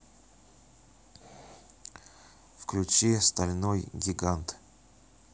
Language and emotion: Russian, neutral